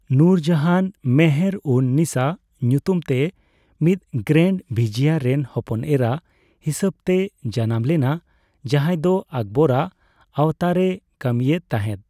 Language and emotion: Santali, neutral